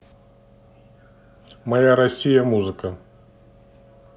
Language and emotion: Russian, neutral